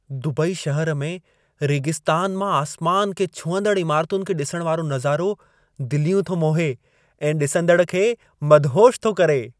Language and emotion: Sindhi, happy